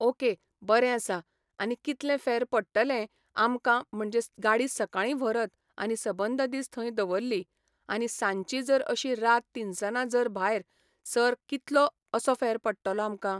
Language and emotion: Goan Konkani, neutral